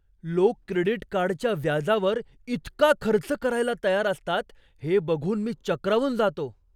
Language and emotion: Marathi, surprised